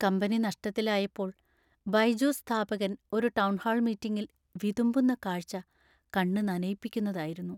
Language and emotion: Malayalam, sad